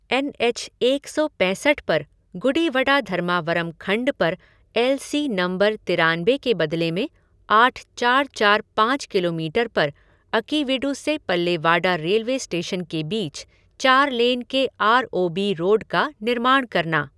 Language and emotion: Hindi, neutral